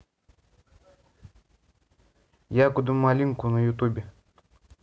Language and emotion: Russian, neutral